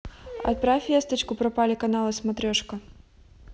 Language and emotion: Russian, neutral